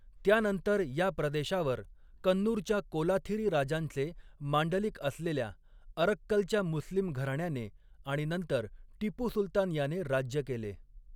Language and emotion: Marathi, neutral